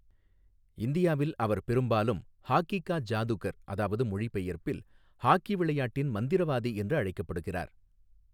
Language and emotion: Tamil, neutral